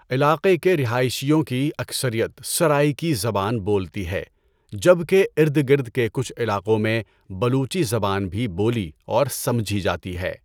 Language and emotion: Urdu, neutral